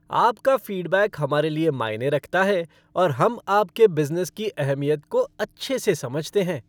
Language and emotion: Hindi, happy